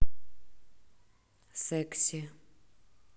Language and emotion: Russian, neutral